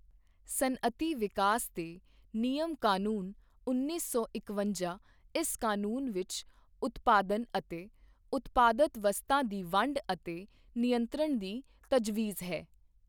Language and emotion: Punjabi, neutral